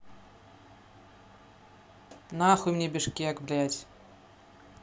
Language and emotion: Russian, angry